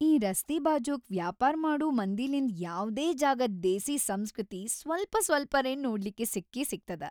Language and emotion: Kannada, happy